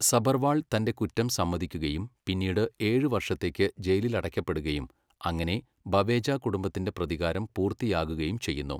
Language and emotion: Malayalam, neutral